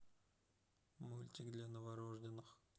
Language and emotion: Russian, neutral